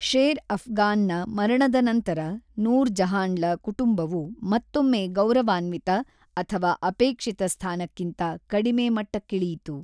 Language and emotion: Kannada, neutral